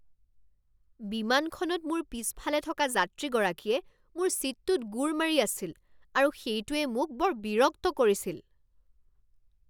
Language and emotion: Assamese, angry